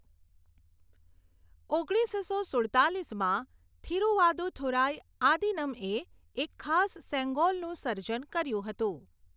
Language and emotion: Gujarati, neutral